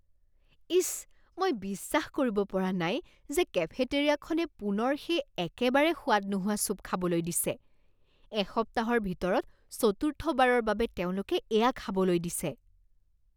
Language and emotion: Assamese, disgusted